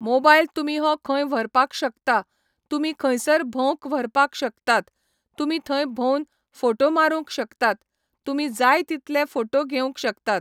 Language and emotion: Goan Konkani, neutral